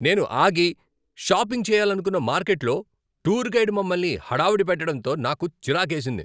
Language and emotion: Telugu, angry